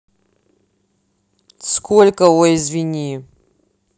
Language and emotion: Russian, angry